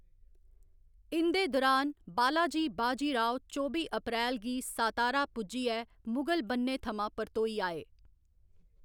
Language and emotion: Dogri, neutral